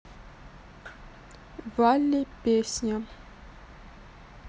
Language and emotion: Russian, neutral